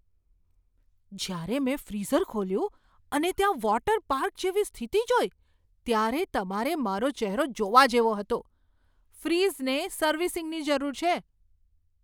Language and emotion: Gujarati, surprised